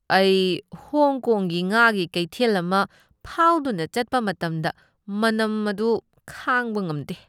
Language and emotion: Manipuri, disgusted